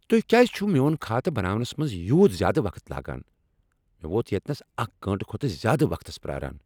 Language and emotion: Kashmiri, angry